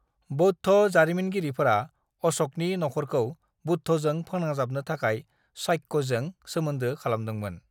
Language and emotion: Bodo, neutral